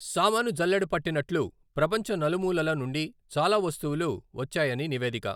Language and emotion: Telugu, neutral